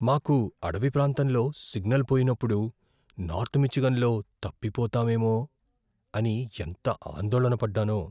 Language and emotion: Telugu, fearful